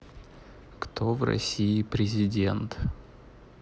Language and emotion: Russian, neutral